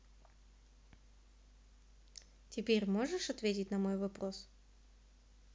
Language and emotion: Russian, neutral